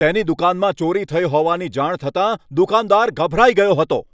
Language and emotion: Gujarati, angry